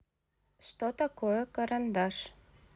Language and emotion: Russian, neutral